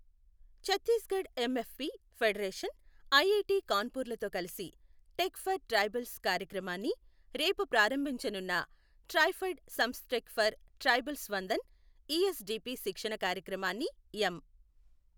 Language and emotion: Telugu, neutral